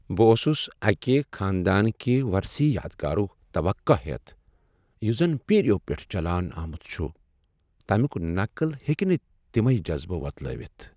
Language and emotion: Kashmiri, sad